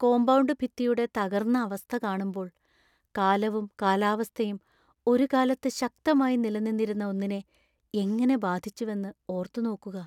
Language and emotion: Malayalam, sad